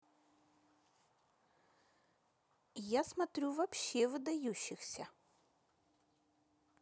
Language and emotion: Russian, neutral